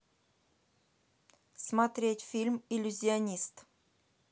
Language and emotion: Russian, neutral